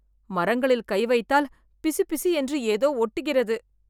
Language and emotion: Tamil, disgusted